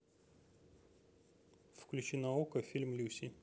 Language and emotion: Russian, neutral